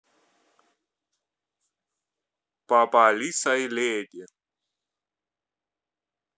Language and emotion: Russian, neutral